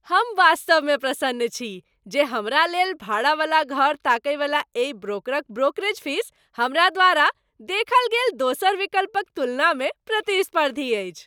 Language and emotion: Maithili, happy